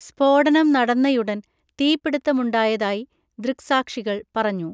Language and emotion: Malayalam, neutral